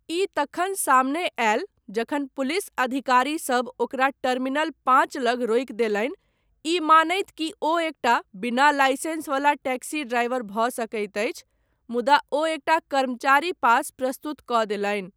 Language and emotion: Maithili, neutral